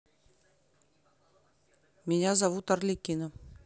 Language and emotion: Russian, neutral